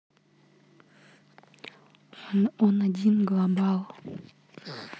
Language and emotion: Russian, neutral